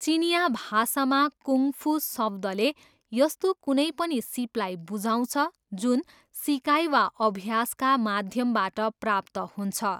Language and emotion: Nepali, neutral